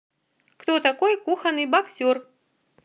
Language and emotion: Russian, neutral